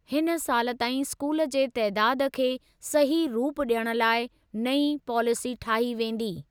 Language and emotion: Sindhi, neutral